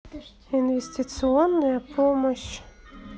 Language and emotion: Russian, neutral